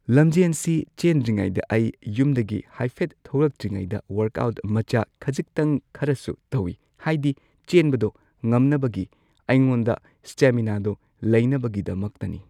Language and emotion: Manipuri, neutral